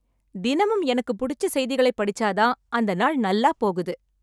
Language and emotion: Tamil, happy